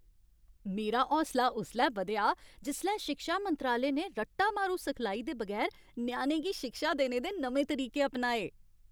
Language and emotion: Dogri, happy